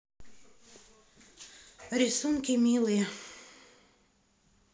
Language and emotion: Russian, sad